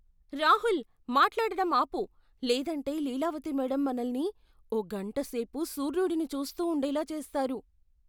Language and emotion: Telugu, fearful